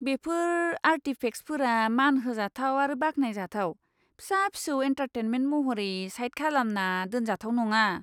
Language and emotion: Bodo, disgusted